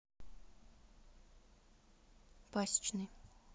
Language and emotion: Russian, neutral